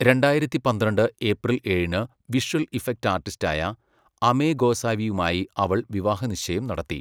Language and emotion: Malayalam, neutral